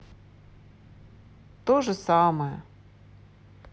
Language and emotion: Russian, sad